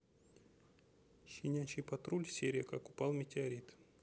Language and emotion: Russian, neutral